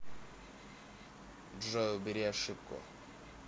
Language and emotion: Russian, neutral